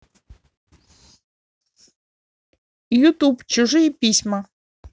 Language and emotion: Russian, positive